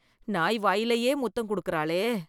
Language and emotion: Tamil, disgusted